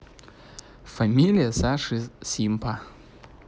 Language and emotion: Russian, neutral